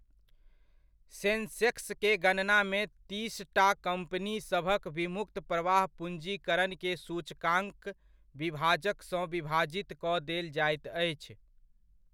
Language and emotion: Maithili, neutral